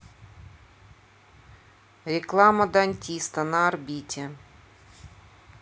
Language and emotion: Russian, neutral